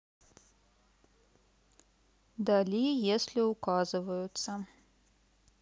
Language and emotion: Russian, neutral